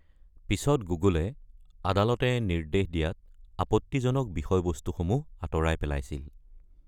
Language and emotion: Assamese, neutral